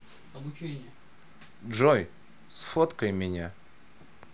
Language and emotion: Russian, neutral